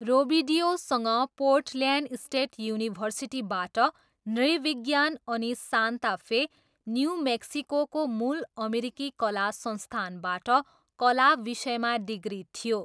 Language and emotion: Nepali, neutral